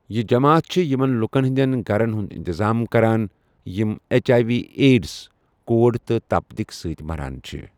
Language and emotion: Kashmiri, neutral